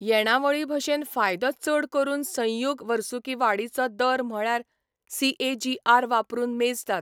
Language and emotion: Goan Konkani, neutral